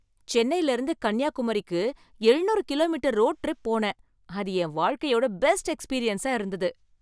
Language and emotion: Tamil, happy